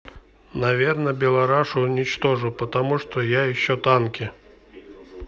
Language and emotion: Russian, neutral